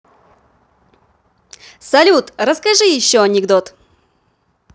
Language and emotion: Russian, positive